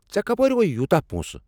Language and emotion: Kashmiri, angry